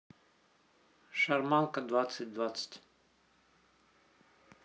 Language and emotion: Russian, neutral